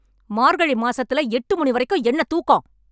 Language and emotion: Tamil, angry